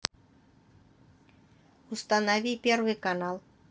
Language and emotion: Russian, neutral